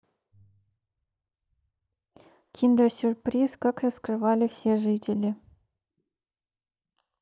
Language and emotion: Russian, neutral